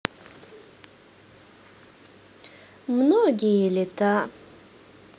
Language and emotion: Russian, positive